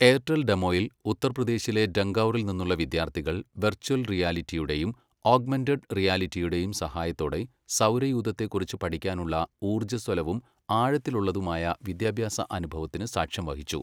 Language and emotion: Malayalam, neutral